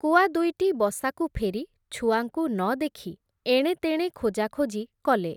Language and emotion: Odia, neutral